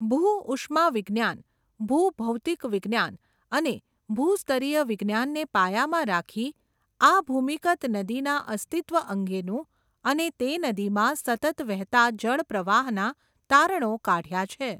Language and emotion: Gujarati, neutral